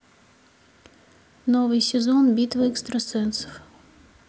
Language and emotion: Russian, neutral